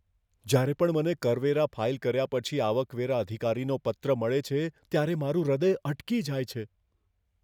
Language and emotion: Gujarati, fearful